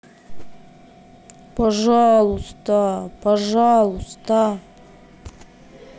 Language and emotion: Russian, sad